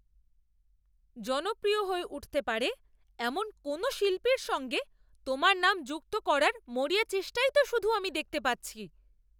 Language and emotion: Bengali, angry